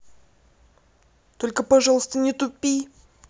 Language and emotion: Russian, angry